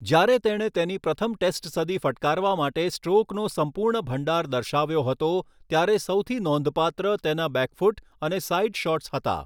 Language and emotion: Gujarati, neutral